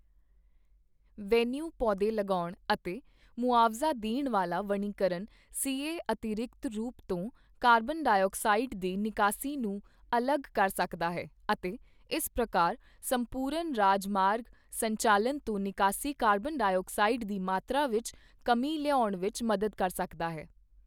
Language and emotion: Punjabi, neutral